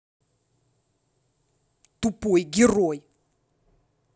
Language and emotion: Russian, angry